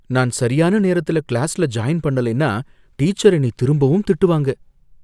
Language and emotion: Tamil, fearful